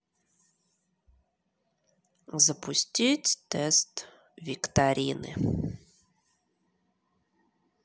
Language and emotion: Russian, neutral